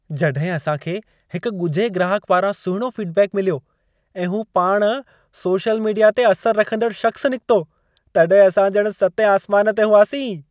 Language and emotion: Sindhi, happy